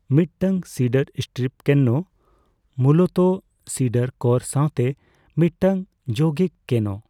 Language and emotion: Santali, neutral